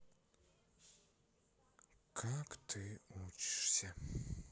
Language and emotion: Russian, sad